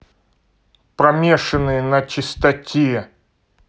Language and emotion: Russian, angry